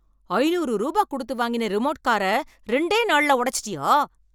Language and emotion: Tamil, angry